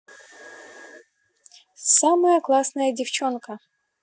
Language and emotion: Russian, positive